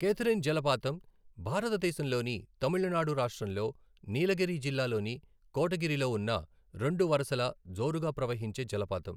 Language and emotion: Telugu, neutral